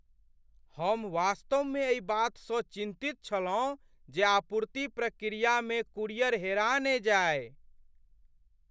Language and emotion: Maithili, fearful